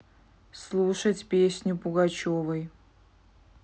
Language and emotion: Russian, neutral